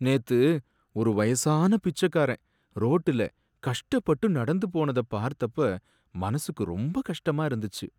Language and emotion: Tamil, sad